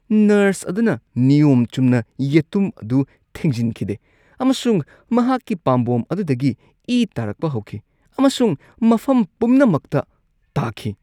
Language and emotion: Manipuri, disgusted